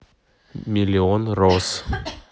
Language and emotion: Russian, neutral